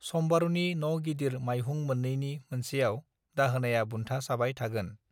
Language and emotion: Bodo, neutral